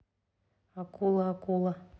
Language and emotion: Russian, neutral